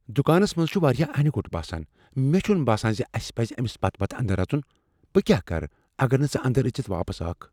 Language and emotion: Kashmiri, fearful